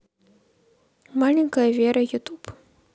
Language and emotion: Russian, neutral